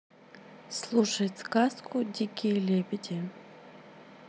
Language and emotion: Russian, neutral